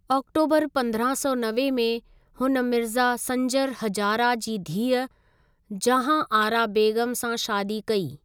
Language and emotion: Sindhi, neutral